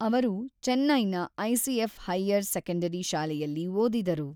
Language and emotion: Kannada, neutral